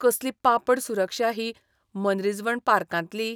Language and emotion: Goan Konkani, disgusted